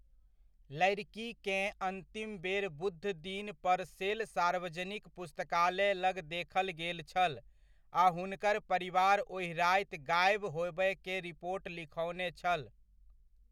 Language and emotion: Maithili, neutral